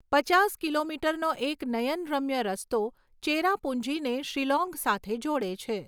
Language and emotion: Gujarati, neutral